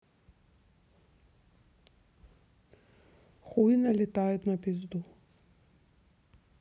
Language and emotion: Russian, neutral